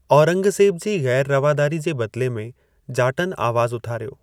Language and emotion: Sindhi, neutral